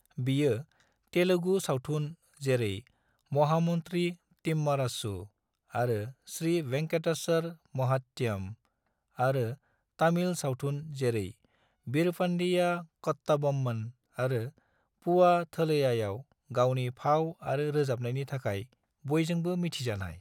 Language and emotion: Bodo, neutral